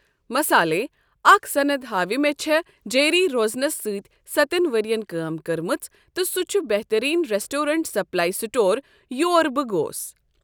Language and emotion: Kashmiri, neutral